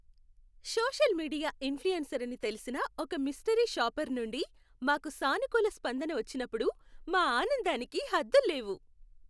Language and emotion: Telugu, happy